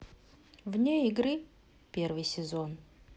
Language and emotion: Russian, neutral